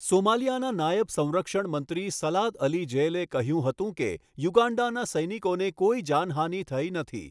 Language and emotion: Gujarati, neutral